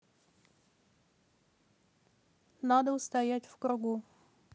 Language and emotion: Russian, neutral